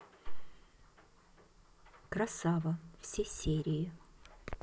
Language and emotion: Russian, neutral